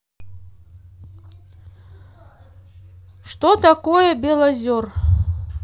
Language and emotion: Russian, neutral